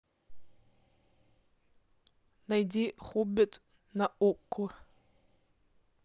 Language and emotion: Russian, neutral